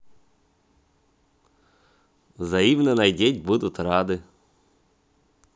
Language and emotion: Russian, positive